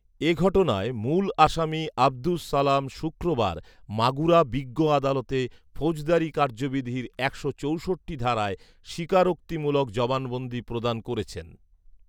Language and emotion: Bengali, neutral